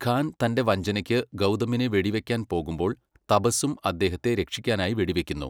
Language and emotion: Malayalam, neutral